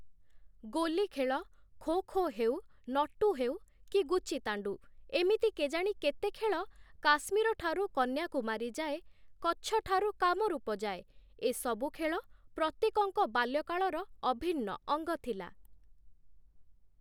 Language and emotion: Odia, neutral